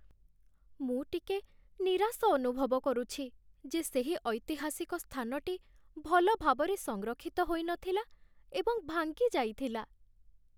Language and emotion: Odia, sad